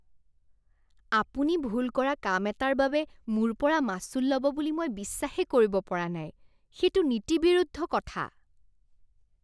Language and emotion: Assamese, disgusted